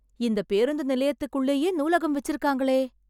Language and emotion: Tamil, surprised